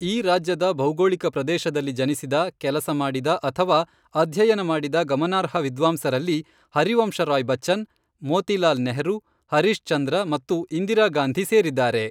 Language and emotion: Kannada, neutral